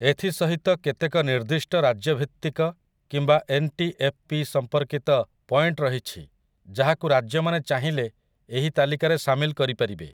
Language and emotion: Odia, neutral